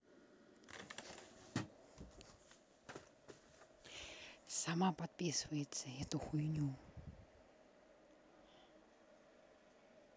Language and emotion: Russian, neutral